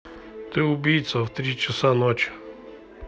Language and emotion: Russian, neutral